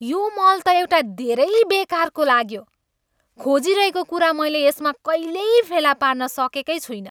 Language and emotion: Nepali, angry